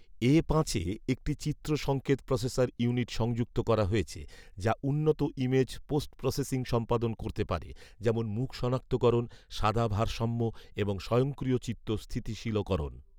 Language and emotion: Bengali, neutral